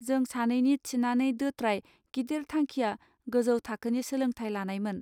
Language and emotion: Bodo, neutral